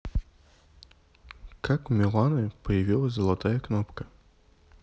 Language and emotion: Russian, neutral